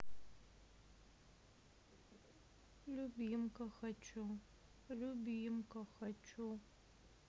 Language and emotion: Russian, sad